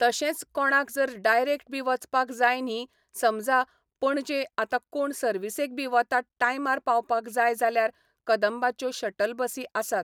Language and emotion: Goan Konkani, neutral